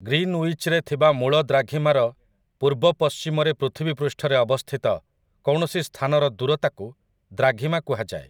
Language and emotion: Odia, neutral